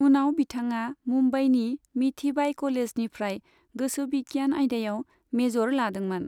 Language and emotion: Bodo, neutral